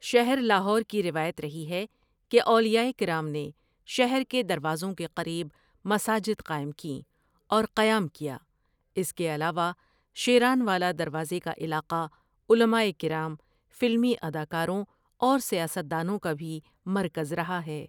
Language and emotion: Urdu, neutral